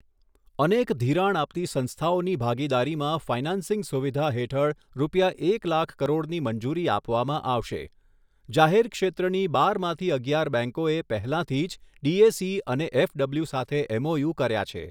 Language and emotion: Gujarati, neutral